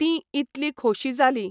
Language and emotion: Goan Konkani, neutral